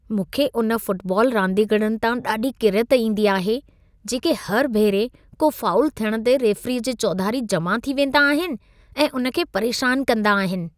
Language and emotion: Sindhi, disgusted